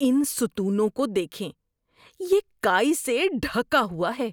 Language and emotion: Urdu, disgusted